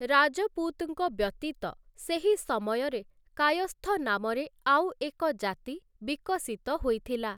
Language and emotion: Odia, neutral